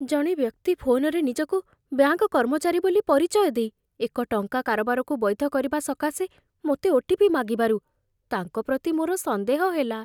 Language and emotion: Odia, fearful